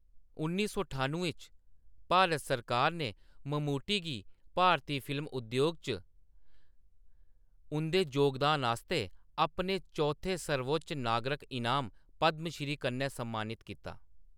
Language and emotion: Dogri, neutral